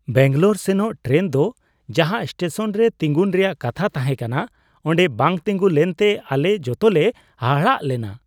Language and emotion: Santali, surprised